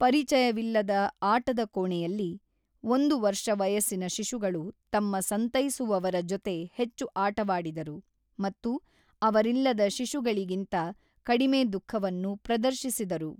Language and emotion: Kannada, neutral